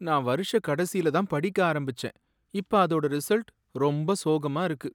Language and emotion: Tamil, sad